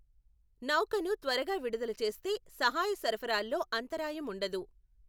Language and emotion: Telugu, neutral